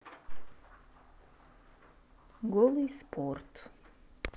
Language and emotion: Russian, neutral